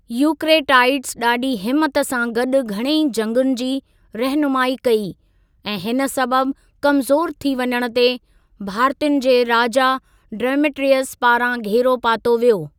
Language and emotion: Sindhi, neutral